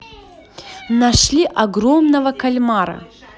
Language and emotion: Russian, positive